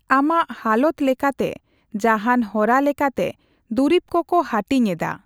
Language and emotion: Santali, neutral